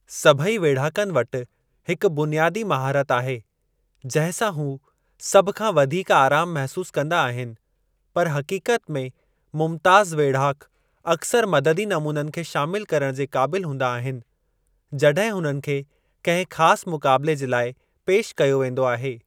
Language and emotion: Sindhi, neutral